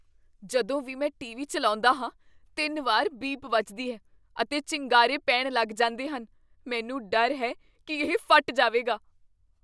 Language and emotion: Punjabi, fearful